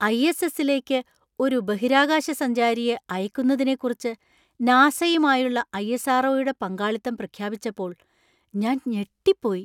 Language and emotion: Malayalam, surprised